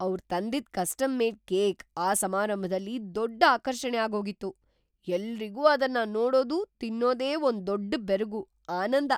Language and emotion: Kannada, surprised